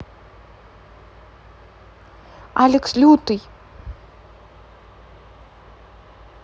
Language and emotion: Russian, neutral